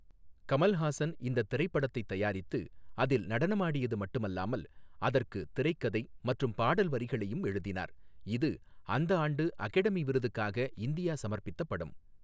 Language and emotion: Tamil, neutral